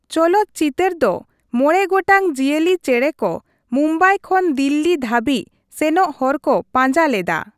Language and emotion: Santali, neutral